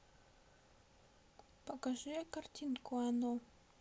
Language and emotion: Russian, neutral